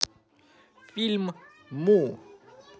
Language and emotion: Russian, positive